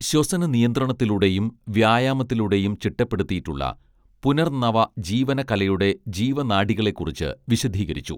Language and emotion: Malayalam, neutral